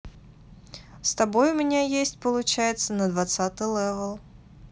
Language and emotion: Russian, neutral